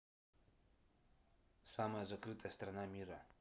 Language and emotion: Russian, neutral